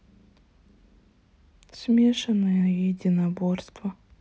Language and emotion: Russian, sad